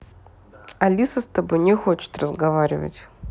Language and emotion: Russian, neutral